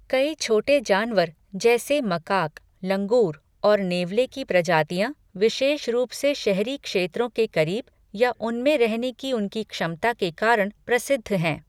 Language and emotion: Hindi, neutral